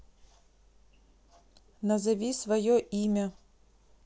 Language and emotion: Russian, neutral